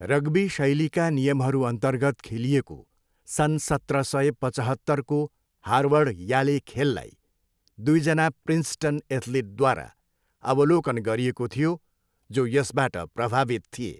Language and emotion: Nepali, neutral